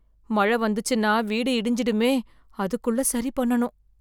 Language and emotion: Tamil, fearful